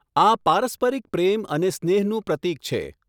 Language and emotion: Gujarati, neutral